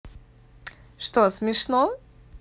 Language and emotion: Russian, positive